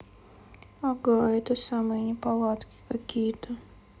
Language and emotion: Russian, sad